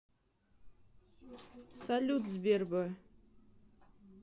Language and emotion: Russian, neutral